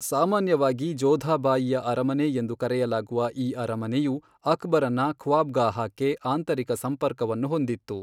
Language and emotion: Kannada, neutral